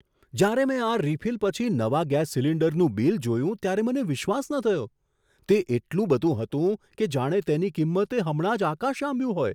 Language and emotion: Gujarati, surprised